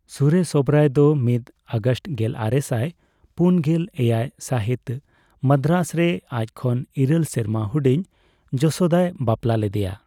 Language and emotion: Santali, neutral